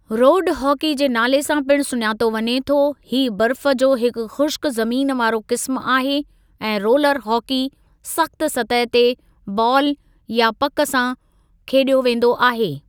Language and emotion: Sindhi, neutral